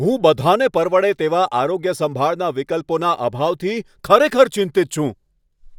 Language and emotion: Gujarati, angry